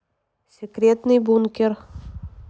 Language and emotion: Russian, neutral